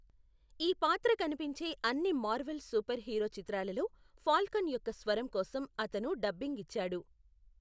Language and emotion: Telugu, neutral